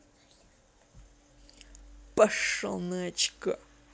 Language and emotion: Russian, angry